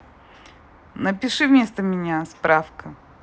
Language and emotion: Russian, neutral